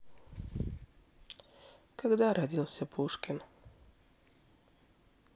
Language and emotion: Russian, sad